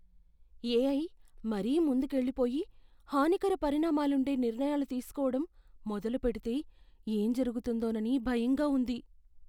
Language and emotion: Telugu, fearful